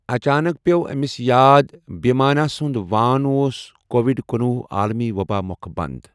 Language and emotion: Kashmiri, neutral